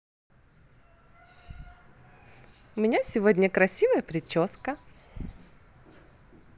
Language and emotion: Russian, positive